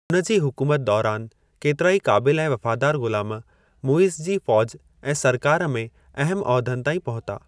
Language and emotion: Sindhi, neutral